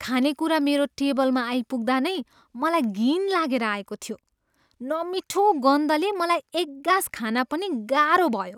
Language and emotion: Nepali, disgusted